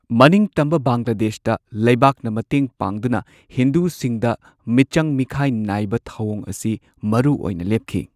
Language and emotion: Manipuri, neutral